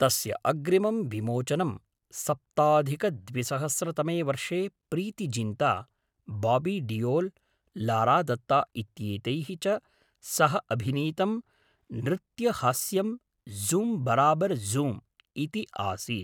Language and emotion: Sanskrit, neutral